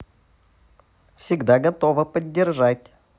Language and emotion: Russian, neutral